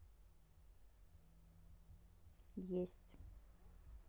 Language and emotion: Russian, neutral